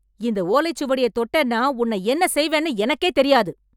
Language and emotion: Tamil, angry